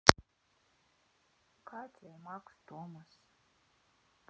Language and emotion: Russian, sad